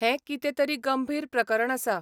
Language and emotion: Goan Konkani, neutral